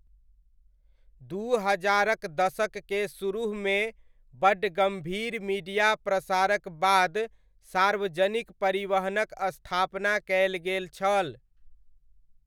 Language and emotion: Maithili, neutral